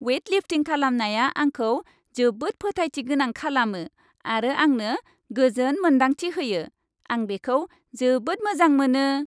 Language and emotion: Bodo, happy